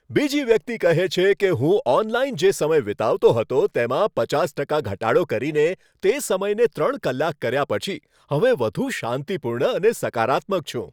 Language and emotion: Gujarati, happy